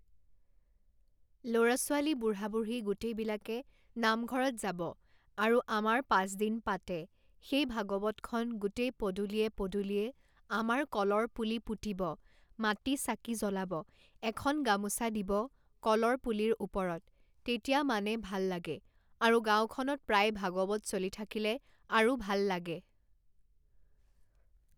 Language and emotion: Assamese, neutral